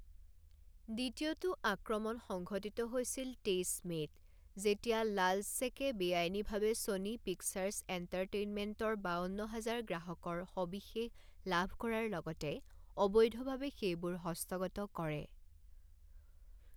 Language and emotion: Assamese, neutral